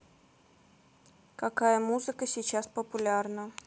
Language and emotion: Russian, neutral